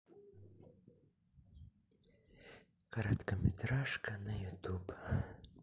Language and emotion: Russian, sad